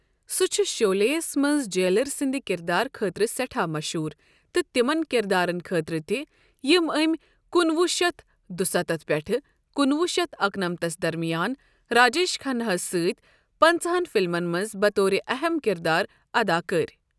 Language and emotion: Kashmiri, neutral